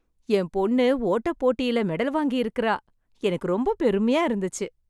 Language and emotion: Tamil, happy